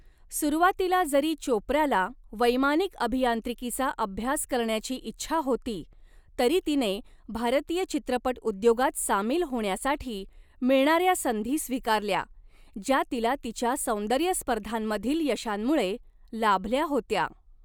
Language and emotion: Marathi, neutral